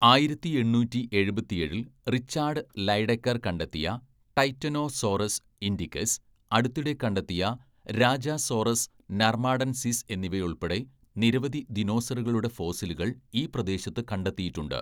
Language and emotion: Malayalam, neutral